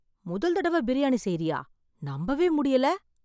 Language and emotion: Tamil, surprised